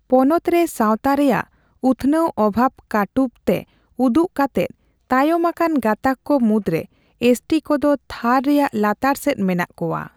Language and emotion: Santali, neutral